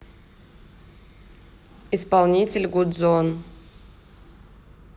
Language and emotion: Russian, neutral